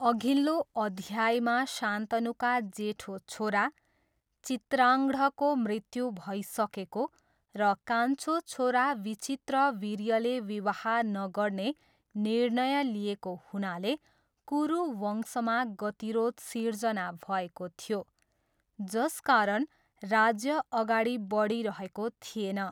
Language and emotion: Nepali, neutral